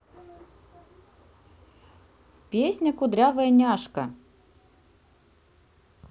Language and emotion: Russian, neutral